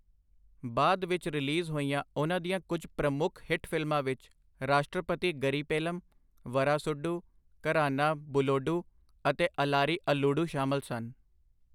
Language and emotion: Punjabi, neutral